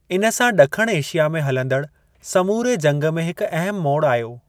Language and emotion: Sindhi, neutral